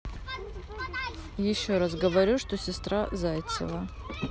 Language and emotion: Russian, neutral